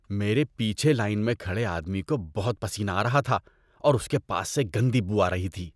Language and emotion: Urdu, disgusted